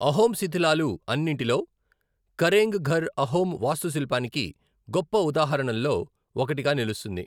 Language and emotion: Telugu, neutral